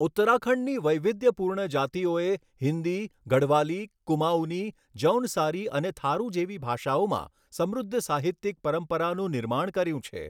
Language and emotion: Gujarati, neutral